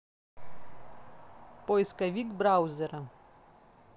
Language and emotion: Russian, neutral